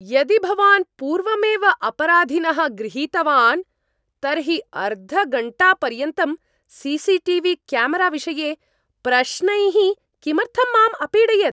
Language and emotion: Sanskrit, angry